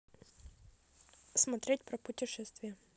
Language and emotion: Russian, neutral